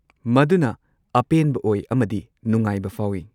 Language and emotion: Manipuri, neutral